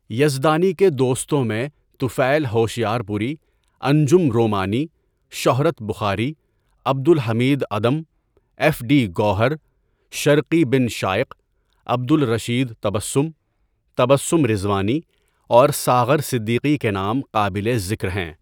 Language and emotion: Urdu, neutral